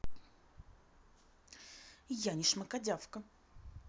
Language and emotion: Russian, angry